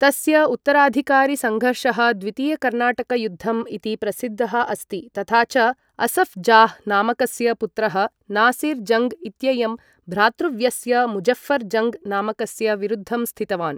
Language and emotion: Sanskrit, neutral